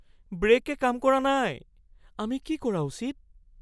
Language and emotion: Assamese, fearful